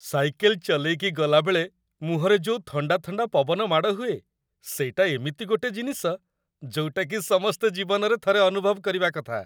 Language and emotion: Odia, happy